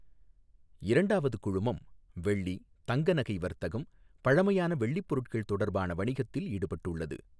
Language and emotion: Tamil, neutral